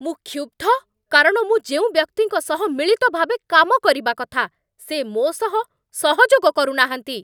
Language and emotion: Odia, angry